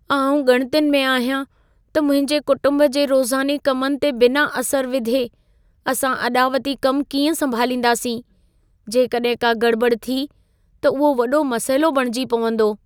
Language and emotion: Sindhi, fearful